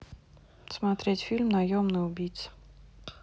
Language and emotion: Russian, neutral